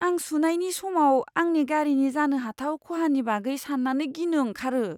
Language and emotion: Bodo, fearful